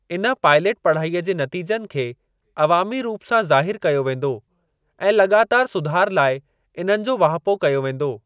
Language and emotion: Sindhi, neutral